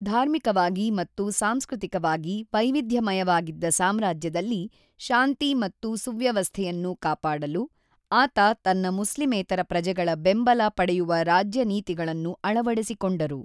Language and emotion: Kannada, neutral